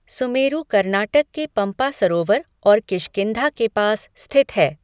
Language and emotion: Hindi, neutral